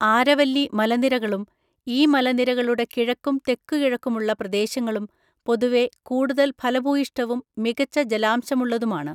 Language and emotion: Malayalam, neutral